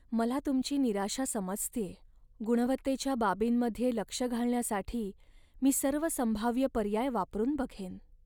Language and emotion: Marathi, sad